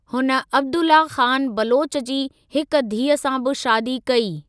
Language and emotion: Sindhi, neutral